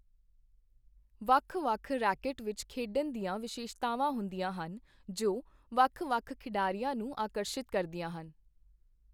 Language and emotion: Punjabi, neutral